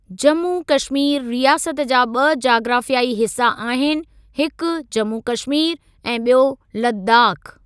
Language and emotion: Sindhi, neutral